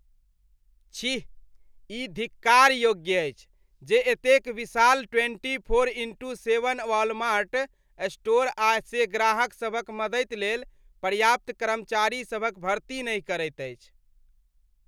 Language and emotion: Maithili, disgusted